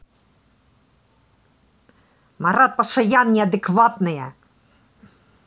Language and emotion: Russian, angry